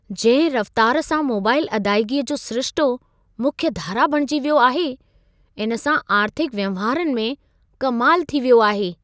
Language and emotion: Sindhi, surprised